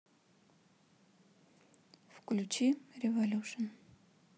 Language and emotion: Russian, neutral